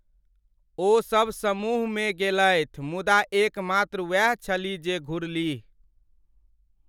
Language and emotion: Maithili, sad